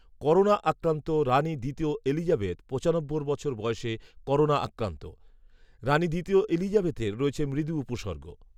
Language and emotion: Bengali, neutral